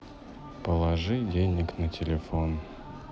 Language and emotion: Russian, neutral